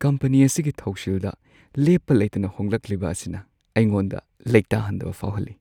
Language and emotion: Manipuri, sad